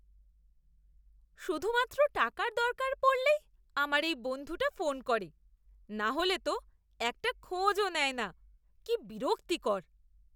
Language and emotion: Bengali, disgusted